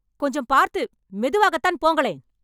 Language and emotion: Tamil, angry